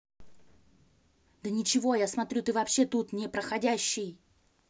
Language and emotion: Russian, angry